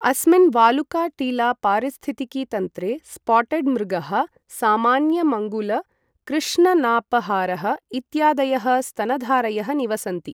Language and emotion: Sanskrit, neutral